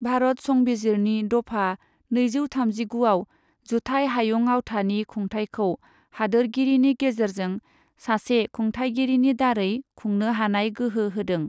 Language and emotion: Bodo, neutral